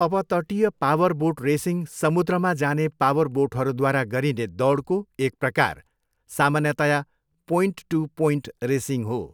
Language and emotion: Nepali, neutral